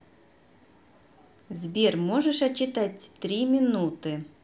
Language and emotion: Russian, neutral